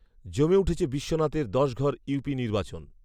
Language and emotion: Bengali, neutral